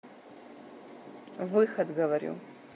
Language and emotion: Russian, neutral